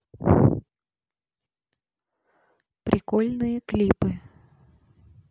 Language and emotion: Russian, neutral